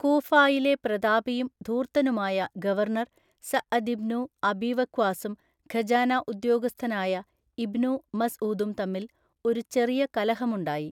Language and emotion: Malayalam, neutral